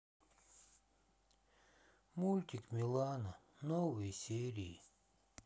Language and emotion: Russian, sad